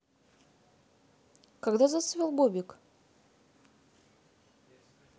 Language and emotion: Russian, neutral